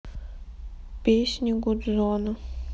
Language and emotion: Russian, sad